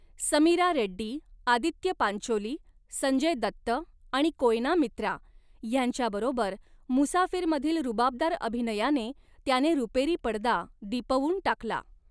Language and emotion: Marathi, neutral